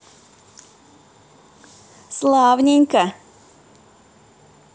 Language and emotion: Russian, positive